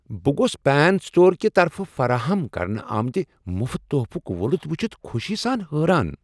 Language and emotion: Kashmiri, surprised